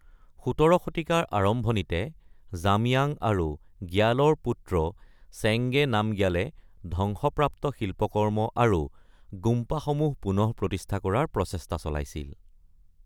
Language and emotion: Assamese, neutral